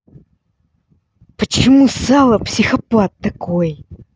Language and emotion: Russian, angry